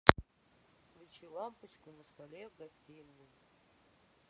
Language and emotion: Russian, sad